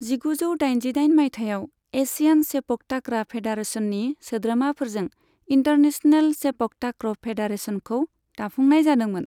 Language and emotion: Bodo, neutral